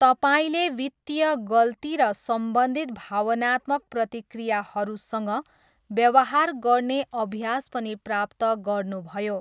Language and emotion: Nepali, neutral